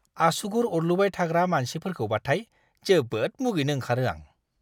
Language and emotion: Bodo, disgusted